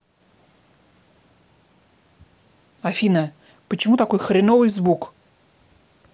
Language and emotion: Russian, angry